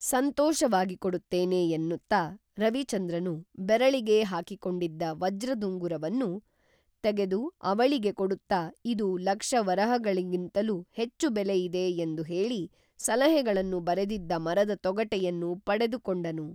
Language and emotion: Kannada, neutral